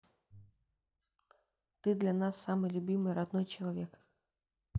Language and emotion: Russian, neutral